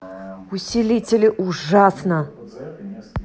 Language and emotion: Russian, angry